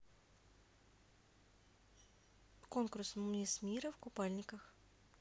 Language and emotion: Russian, neutral